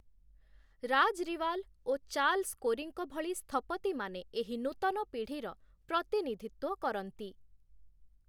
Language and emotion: Odia, neutral